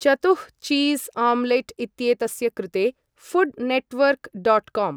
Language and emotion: Sanskrit, neutral